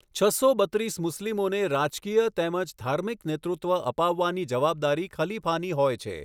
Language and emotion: Gujarati, neutral